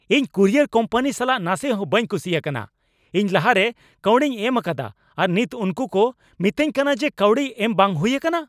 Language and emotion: Santali, angry